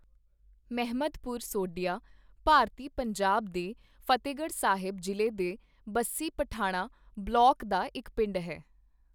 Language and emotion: Punjabi, neutral